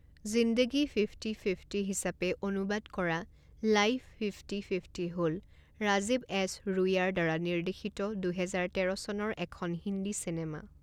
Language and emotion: Assamese, neutral